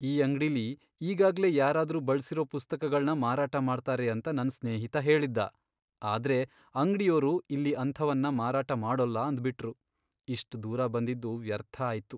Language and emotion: Kannada, sad